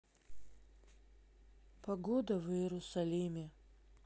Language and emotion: Russian, neutral